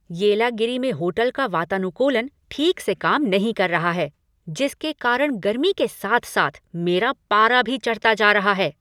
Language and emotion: Hindi, angry